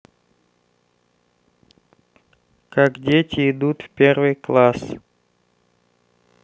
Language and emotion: Russian, neutral